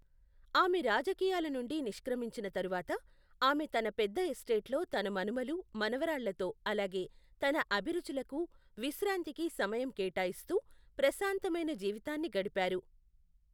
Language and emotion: Telugu, neutral